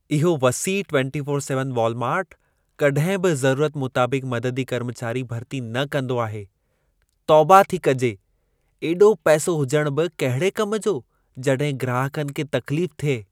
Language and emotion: Sindhi, disgusted